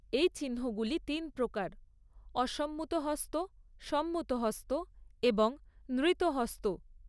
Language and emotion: Bengali, neutral